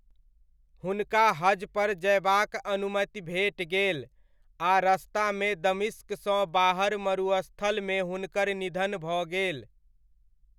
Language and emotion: Maithili, neutral